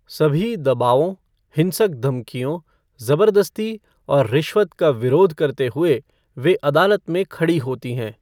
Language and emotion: Hindi, neutral